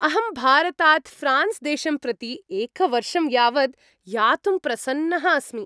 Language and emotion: Sanskrit, happy